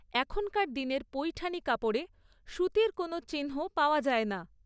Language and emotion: Bengali, neutral